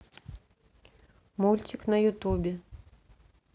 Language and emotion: Russian, neutral